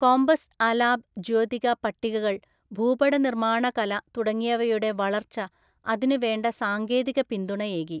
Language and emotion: Malayalam, neutral